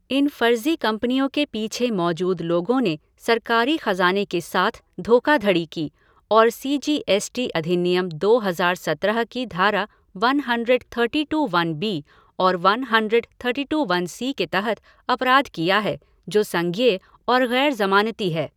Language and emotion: Hindi, neutral